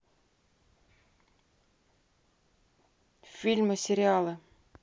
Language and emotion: Russian, neutral